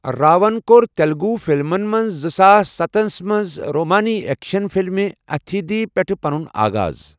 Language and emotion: Kashmiri, neutral